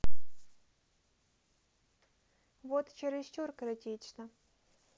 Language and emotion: Russian, neutral